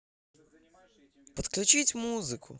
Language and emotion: Russian, positive